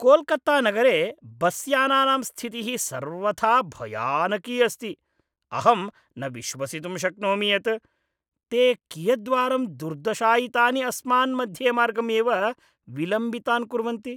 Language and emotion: Sanskrit, disgusted